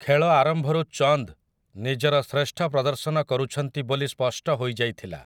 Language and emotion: Odia, neutral